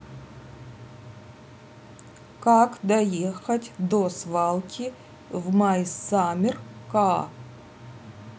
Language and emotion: Russian, neutral